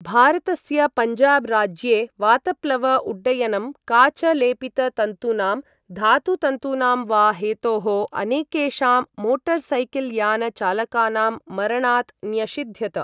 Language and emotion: Sanskrit, neutral